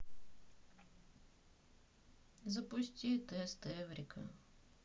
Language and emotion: Russian, sad